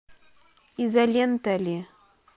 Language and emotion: Russian, neutral